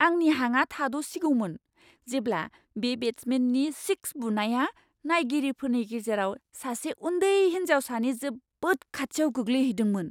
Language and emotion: Bodo, surprised